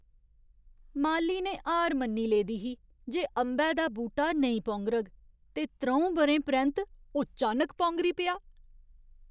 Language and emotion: Dogri, surprised